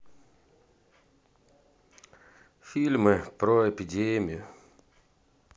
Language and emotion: Russian, sad